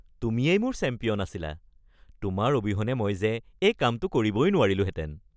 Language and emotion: Assamese, happy